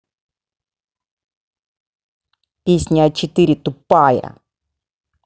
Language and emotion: Russian, angry